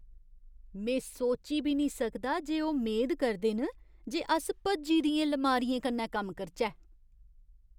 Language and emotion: Dogri, disgusted